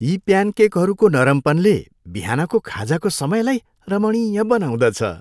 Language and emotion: Nepali, happy